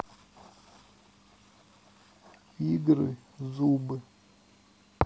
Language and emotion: Russian, neutral